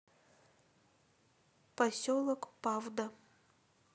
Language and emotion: Russian, neutral